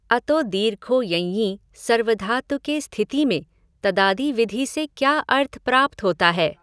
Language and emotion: Hindi, neutral